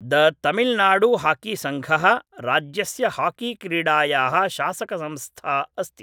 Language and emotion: Sanskrit, neutral